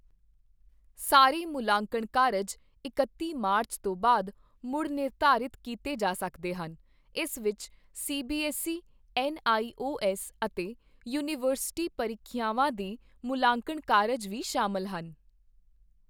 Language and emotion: Punjabi, neutral